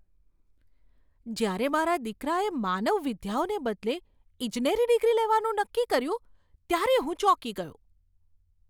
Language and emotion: Gujarati, surprised